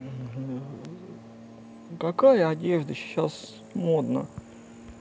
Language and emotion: Russian, neutral